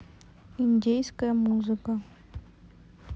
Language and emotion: Russian, neutral